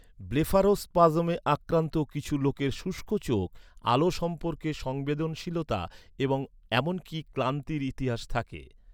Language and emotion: Bengali, neutral